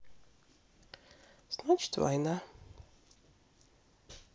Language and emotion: Russian, sad